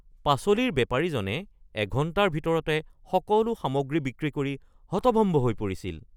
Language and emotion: Assamese, surprised